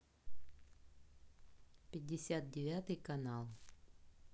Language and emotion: Russian, neutral